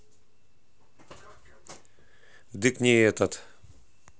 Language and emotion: Russian, neutral